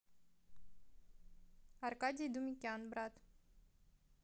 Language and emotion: Russian, neutral